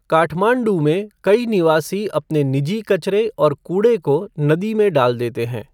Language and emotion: Hindi, neutral